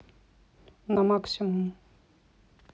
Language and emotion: Russian, neutral